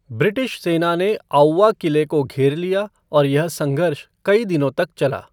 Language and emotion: Hindi, neutral